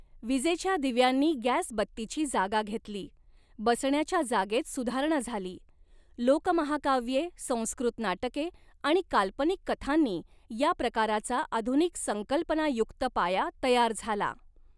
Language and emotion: Marathi, neutral